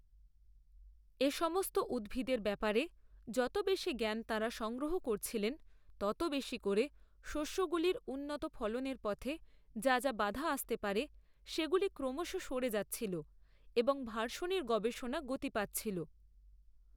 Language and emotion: Bengali, neutral